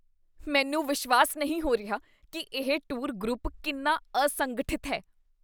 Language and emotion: Punjabi, disgusted